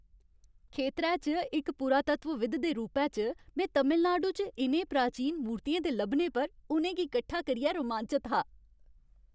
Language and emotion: Dogri, happy